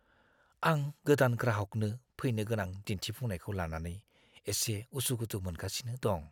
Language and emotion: Bodo, fearful